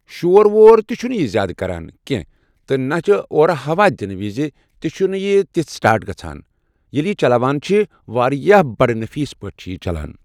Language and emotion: Kashmiri, neutral